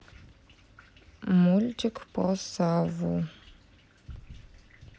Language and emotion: Russian, neutral